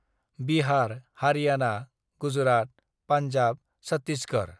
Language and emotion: Bodo, neutral